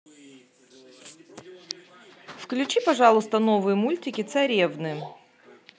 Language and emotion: Russian, neutral